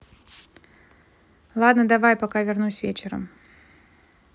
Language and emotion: Russian, neutral